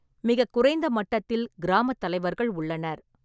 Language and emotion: Tamil, neutral